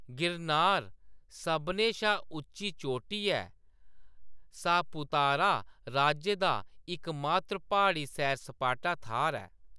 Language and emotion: Dogri, neutral